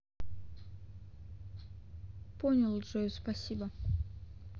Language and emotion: Russian, neutral